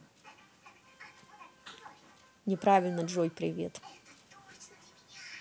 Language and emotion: Russian, neutral